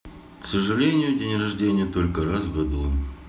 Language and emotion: Russian, neutral